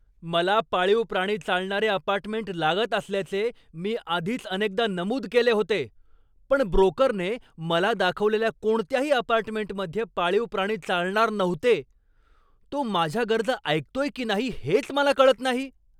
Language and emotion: Marathi, angry